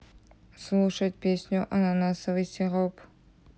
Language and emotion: Russian, neutral